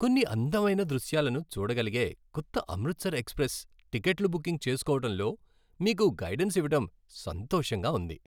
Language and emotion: Telugu, happy